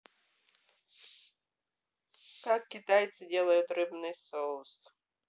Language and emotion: Russian, neutral